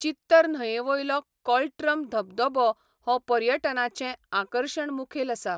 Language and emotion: Goan Konkani, neutral